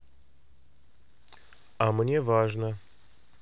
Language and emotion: Russian, neutral